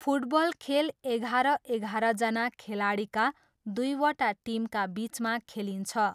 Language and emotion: Nepali, neutral